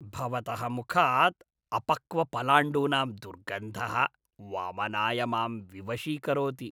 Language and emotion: Sanskrit, disgusted